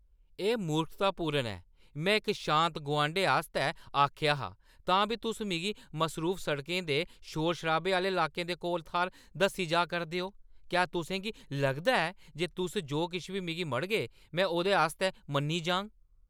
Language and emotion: Dogri, angry